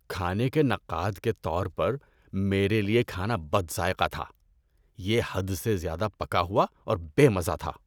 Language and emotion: Urdu, disgusted